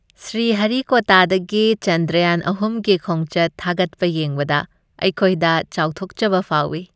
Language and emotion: Manipuri, happy